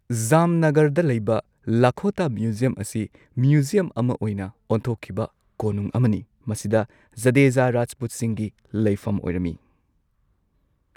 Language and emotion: Manipuri, neutral